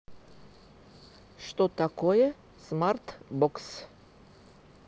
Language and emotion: Russian, neutral